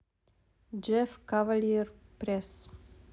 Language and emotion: Russian, neutral